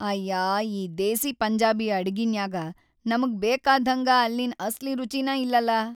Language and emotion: Kannada, sad